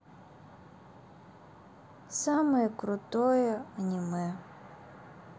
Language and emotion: Russian, sad